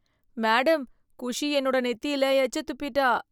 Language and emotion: Tamil, disgusted